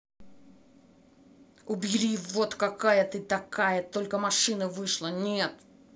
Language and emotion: Russian, angry